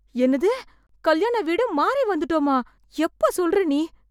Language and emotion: Tamil, fearful